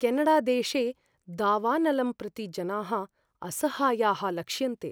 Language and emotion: Sanskrit, fearful